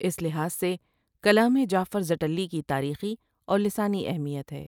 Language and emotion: Urdu, neutral